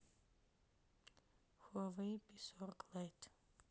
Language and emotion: Russian, sad